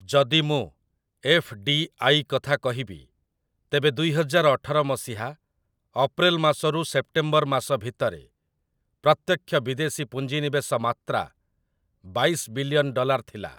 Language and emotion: Odia, neutral